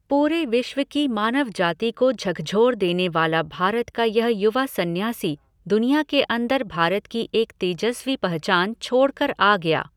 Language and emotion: Hindi, neutral